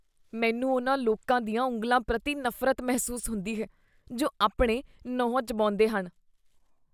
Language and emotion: Punjabi, disgusted